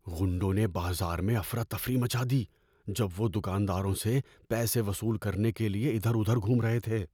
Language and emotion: Urdu, fearful